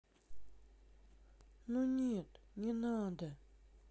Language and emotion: Russian, sad